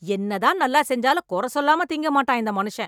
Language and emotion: Tamil, angry